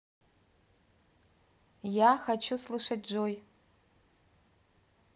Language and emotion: Russian, neutral